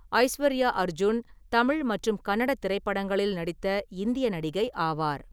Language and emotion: Tamil, neutral